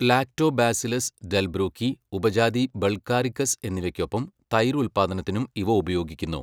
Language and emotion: Malayalam, neutral